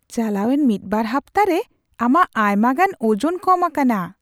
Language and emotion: Santali, surprised